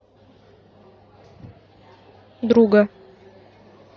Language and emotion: Russian, neutral